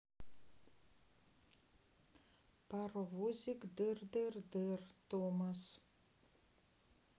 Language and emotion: Russian, neutral